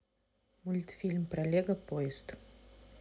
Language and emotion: Russian, neutral